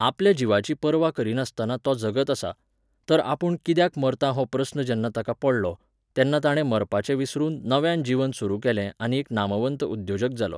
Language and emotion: Goan Konkani, neutral